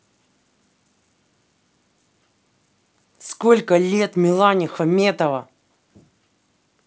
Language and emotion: Russian, angry